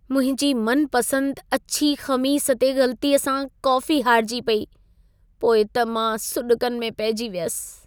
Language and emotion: Sindhi, sad